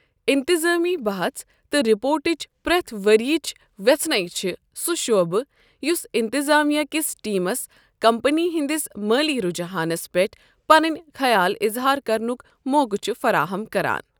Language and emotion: Kashmiri, neutral